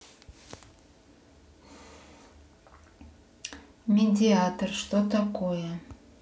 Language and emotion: Russian, neutral